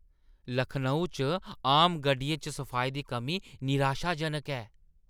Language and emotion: Dogri, disgusted